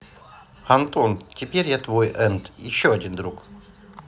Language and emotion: Russian, neutral